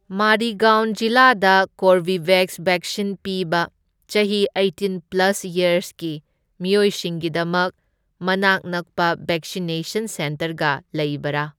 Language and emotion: Manipuri, neutral